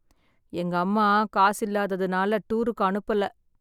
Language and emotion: Tamil, sad